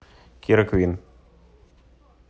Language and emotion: Russian, neutral